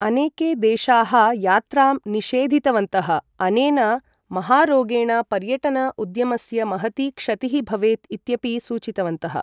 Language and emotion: Sanskrit, neutral